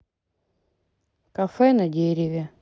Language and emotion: Russian, neutral